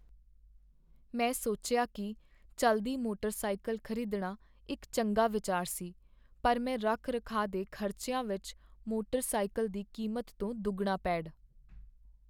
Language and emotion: Punjabi, sad